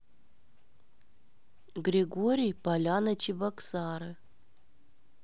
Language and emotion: Russian, neutral